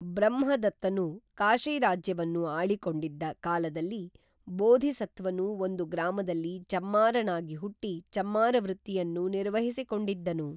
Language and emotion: Kannada, neutral